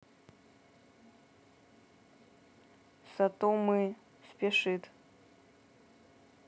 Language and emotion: Russian, neutral